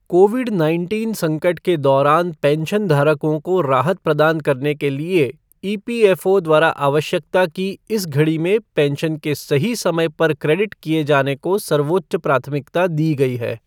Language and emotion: Hindi, neutral